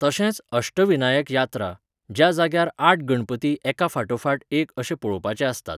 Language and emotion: Goan Konkani, neutral